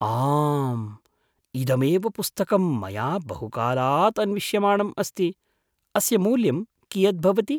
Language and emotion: Sanskrit, surprised